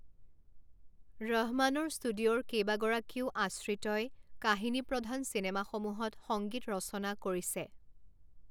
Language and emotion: Assamese, neutral